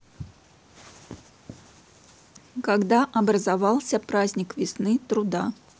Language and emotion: Russian, neutral